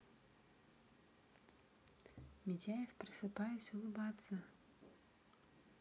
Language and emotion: Russian, neutral